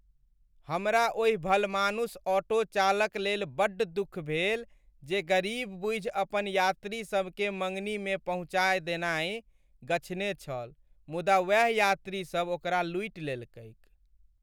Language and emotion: Maithili, sad